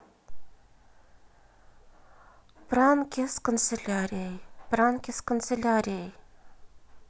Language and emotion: Russian, neutral